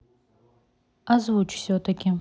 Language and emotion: Russian, neutral